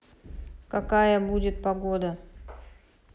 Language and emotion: Russian, neutral